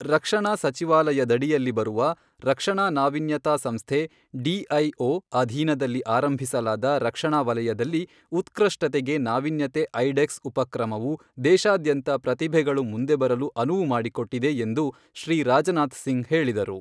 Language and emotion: Kannada, neutral